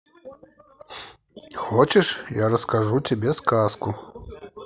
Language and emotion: Russian, positive